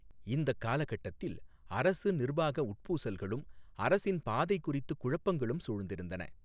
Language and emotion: Tamil, neutral